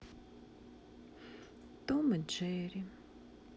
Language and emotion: Russian, sad